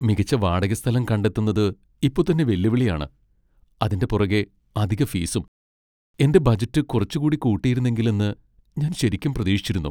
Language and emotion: Malayalam, sad